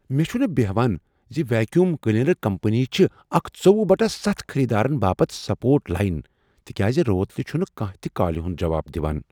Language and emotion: Kashmiri, surprised